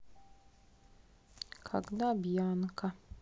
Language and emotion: Russian, sad